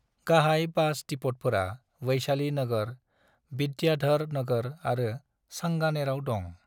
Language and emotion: Bodo, neutral